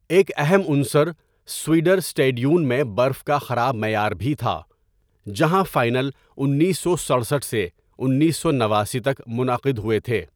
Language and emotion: Urdu, neutral